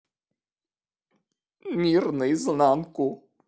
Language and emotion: Russian, sad